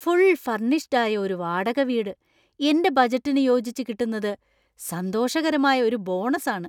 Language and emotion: Malayalam, surprised